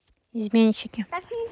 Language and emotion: Russian, neutral